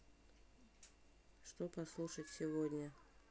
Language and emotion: Russian, neutral